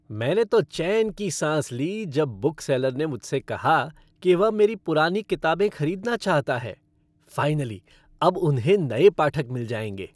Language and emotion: Hindi, happy